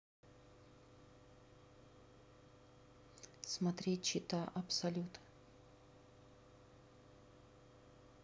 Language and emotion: Russian, neutral